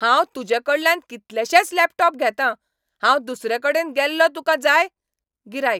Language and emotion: Goan Konkani, angry